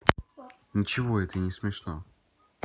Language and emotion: Russian, neutral